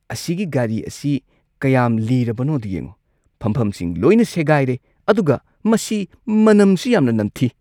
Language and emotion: Manipuri, disgusted